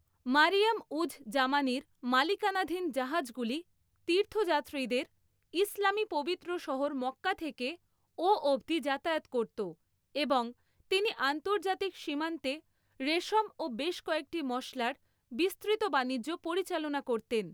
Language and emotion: Bengali, neutral